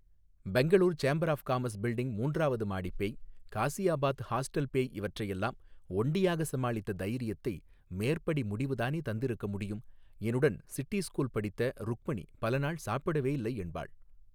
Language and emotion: Tamil, neutral